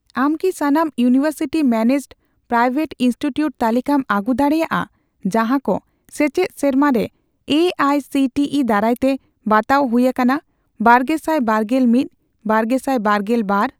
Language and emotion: Santali, neutral